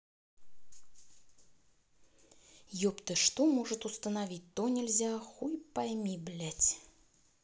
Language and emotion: Russian, angry